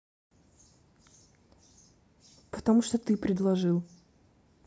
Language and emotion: Russian, neutral